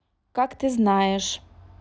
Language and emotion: Russian, neutral